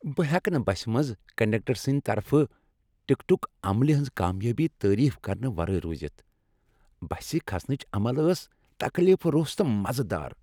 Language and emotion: Kashmiri, happy